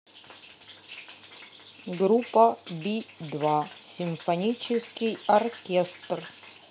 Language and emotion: Russian, neutral